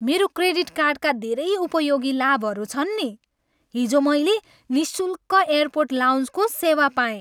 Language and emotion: Nepali, happy